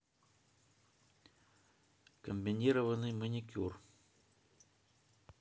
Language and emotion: Russian, neutral